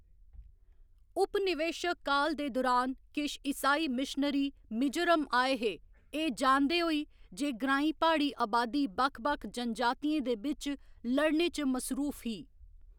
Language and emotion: Dogri, neutral